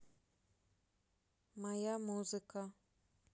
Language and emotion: Russian, neutral